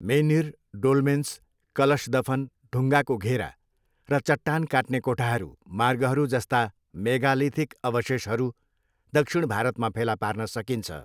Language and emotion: Nepali, neutral